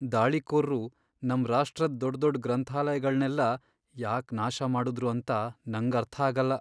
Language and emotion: Kannada, sad